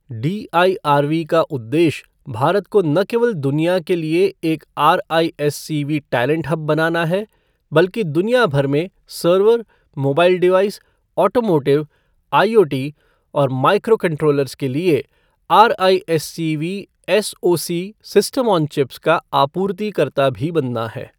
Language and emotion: Hindi, neutral